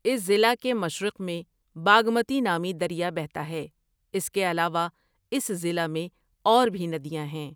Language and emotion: Urdu, neutral